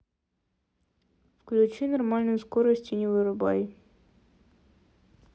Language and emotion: Russian, neutral